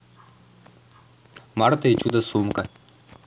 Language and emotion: Russian, neutral